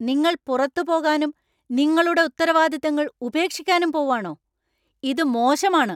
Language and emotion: Malayalam, angry